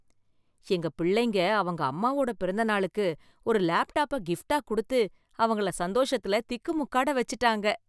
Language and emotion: Tamil, happy